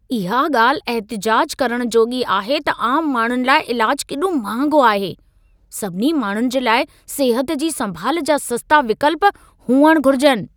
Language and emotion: Sindhi, angry